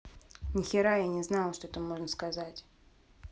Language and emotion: Russian, angry